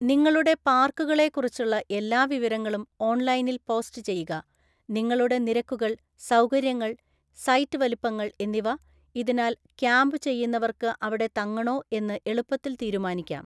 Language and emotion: Malayalam, neutral